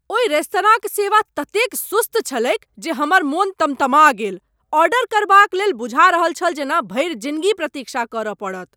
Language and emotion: Maithili, angry